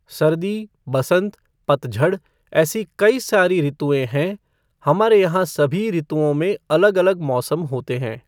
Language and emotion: Hindi, neutral